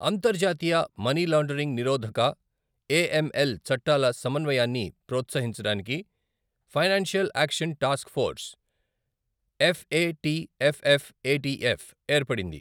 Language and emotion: Telugu, neutral